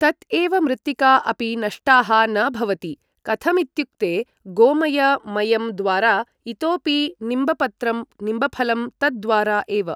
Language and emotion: Sanskrit, neutral